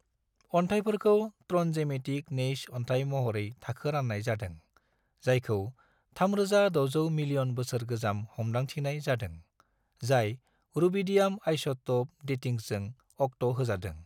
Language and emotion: Bodo, neutral